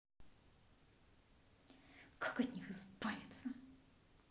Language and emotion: Russian, angry